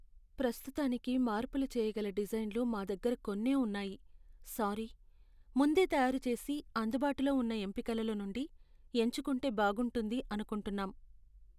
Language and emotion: Telugu, sad